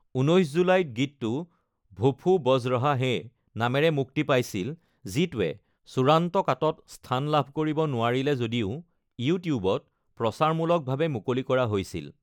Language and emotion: Assamese, neutral